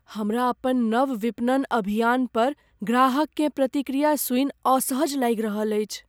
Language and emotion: Maithili, fearful